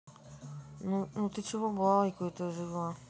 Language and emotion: Russian, neutral